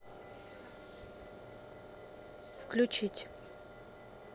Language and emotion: Russian, neutral